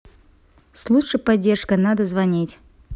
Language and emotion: Russian, neutral